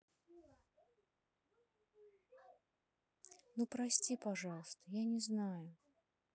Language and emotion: Russian, sad